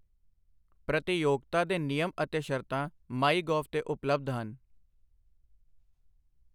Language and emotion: Punjabi, neutral